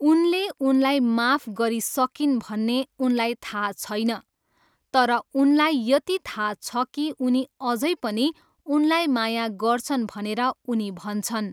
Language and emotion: Nepali, neutral